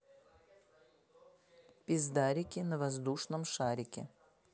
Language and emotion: Russian, neutral